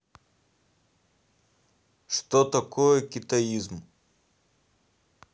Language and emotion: Russian, neutral